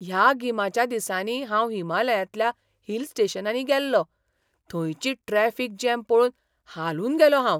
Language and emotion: Goan Konkani, surprised